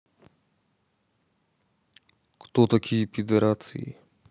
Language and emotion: Russian, neutral